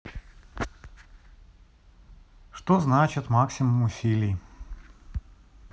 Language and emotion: Russian, neutral